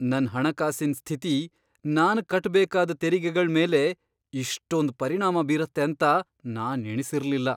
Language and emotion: Kannada, surprised